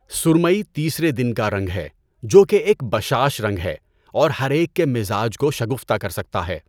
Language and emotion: Urdu, neutral